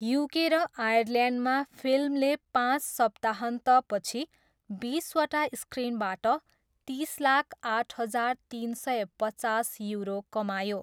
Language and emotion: Nepali, neutral